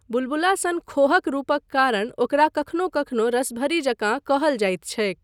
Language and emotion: Maithili, neutral